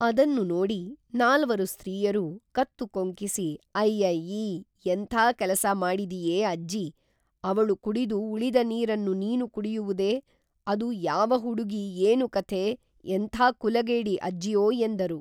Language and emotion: Kannada, neutral